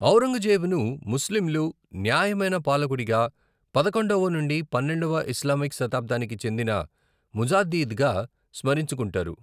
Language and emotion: Telugu, neutral